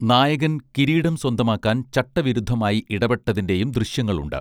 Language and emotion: Malayalam, neutral